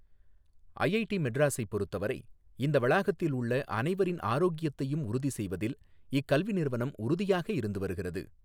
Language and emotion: Tamil, neutral